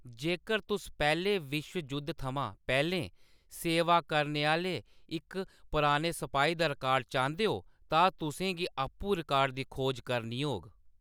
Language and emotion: Dogri, neutral